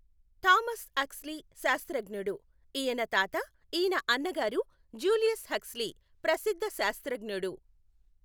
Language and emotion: Telugu, neutral